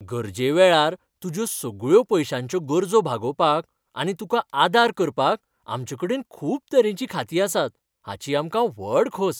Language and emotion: Goan Konkani, happy